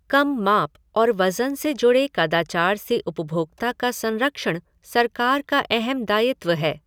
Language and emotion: Hindi, neutral